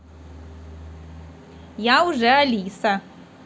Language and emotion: Russian, positive